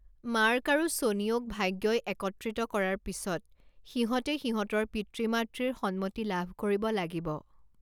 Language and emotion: Assamese, neutral